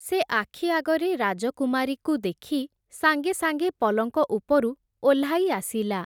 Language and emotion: Odia, neutral